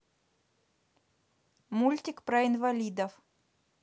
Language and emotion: Russian, neutral